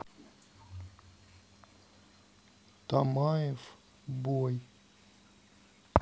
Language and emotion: Russian, neutral